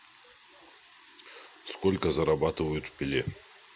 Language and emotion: Russian, neutral